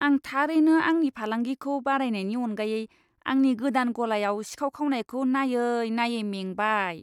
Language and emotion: Bodo, disgusted